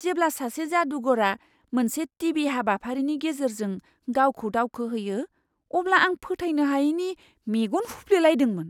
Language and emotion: Bodo, surprised